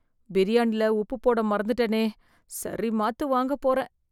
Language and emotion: Tamil, fearful